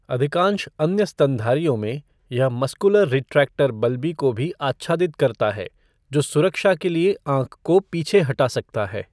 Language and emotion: Hindi, neutral